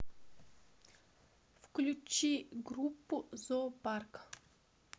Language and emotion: Russian, neutral